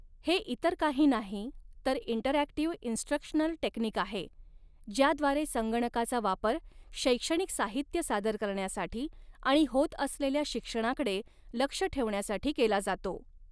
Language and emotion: Marathi, neutral